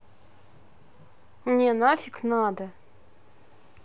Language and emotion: Russian, angry